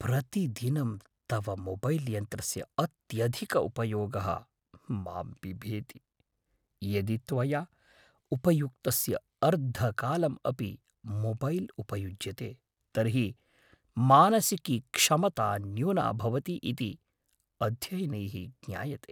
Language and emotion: Sanskrit, fearful